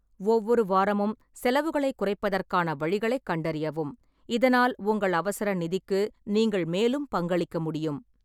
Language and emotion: Tamil, neutral